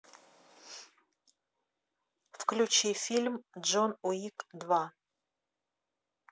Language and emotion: Russian, neutral